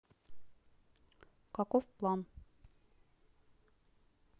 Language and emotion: Russian, neutral